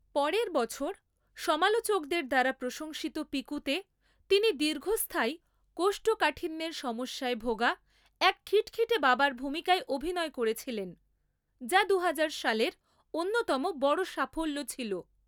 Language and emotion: Bengali, neutral